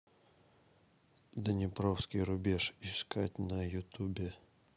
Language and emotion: Russian, neutral